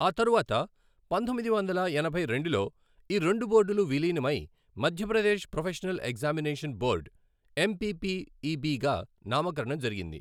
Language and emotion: Telugu, neutral